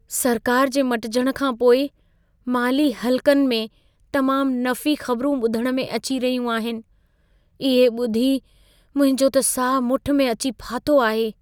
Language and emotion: Sindhi, fearful